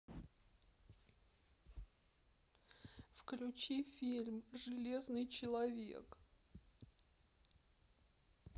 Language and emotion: Russian, sad